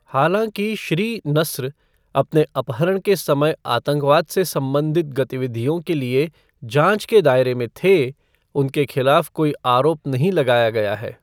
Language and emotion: Hindi, neutral